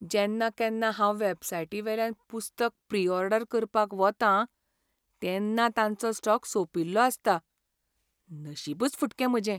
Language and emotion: Goan Konkani, sad